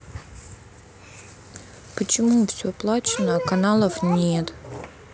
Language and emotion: Russian, sad